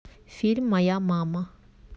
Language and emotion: Russian, neutral